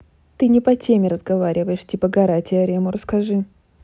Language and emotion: Russian, neutral